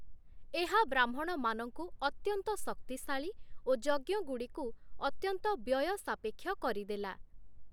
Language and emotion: Odia, neutral